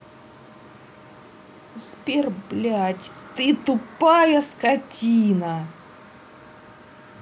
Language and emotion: Russian, angry